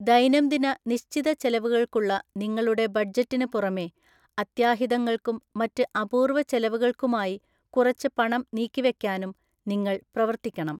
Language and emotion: Malayalam, neutral